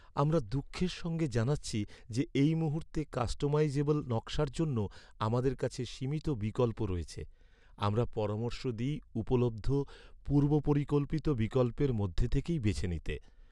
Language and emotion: Bengali, sad